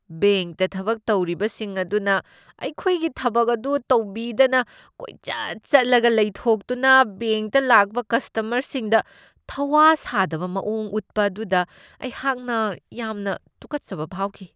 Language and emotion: Manipuri, disgusted